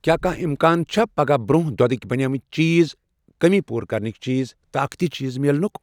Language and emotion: Kashmiri, neutral